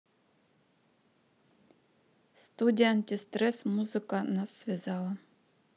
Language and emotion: Russian, neutral